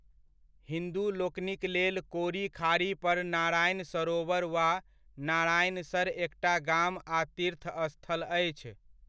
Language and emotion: Maithili, neutral